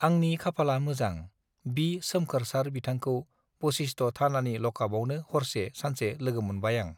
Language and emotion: Bodo, neutral